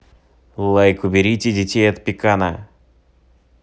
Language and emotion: Russian, neutral